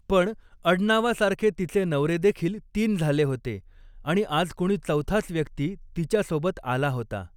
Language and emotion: Marathi, neutral